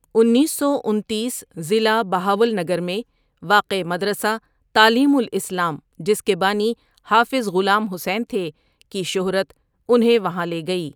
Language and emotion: Urdu, neutral